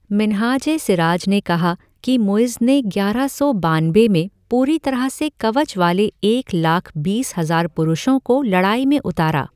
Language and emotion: Hindi, neutral